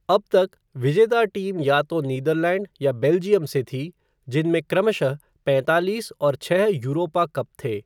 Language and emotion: Hindi, neutral